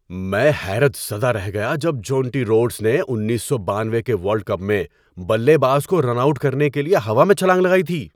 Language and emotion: Urdu, surprised